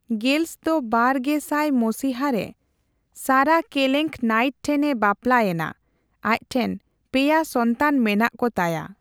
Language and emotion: Santali, neutral